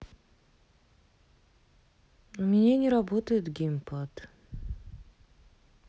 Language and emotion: Russian, sad